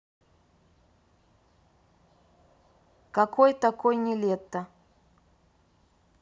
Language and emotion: Russian, neutral